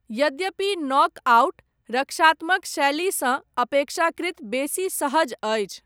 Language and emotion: Maithili, neutral